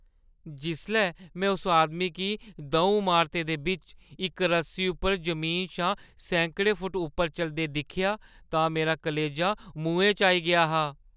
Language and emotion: Dogri, fearful